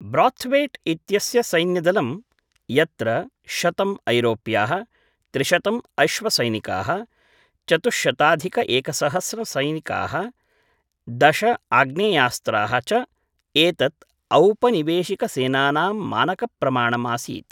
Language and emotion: Sanskrit, neutral